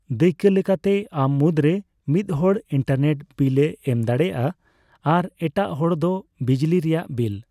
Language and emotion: Santali, neutral